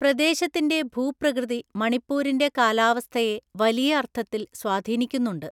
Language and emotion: Malayalam, neutral